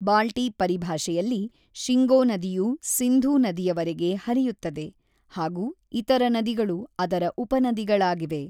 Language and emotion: Kannada, neutral